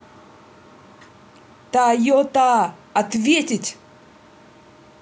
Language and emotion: Russian, angry